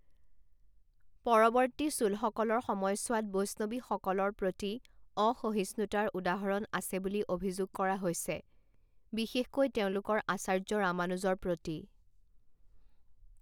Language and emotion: Assamese, neutral